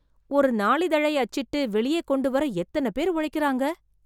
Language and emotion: Tamil, surprised